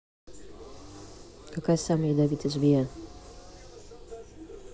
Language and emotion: Russian, neutral